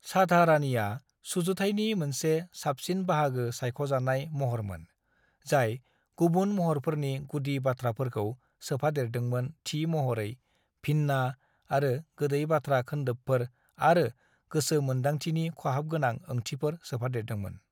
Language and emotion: Bodo, neutral